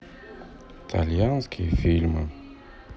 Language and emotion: Russian, sad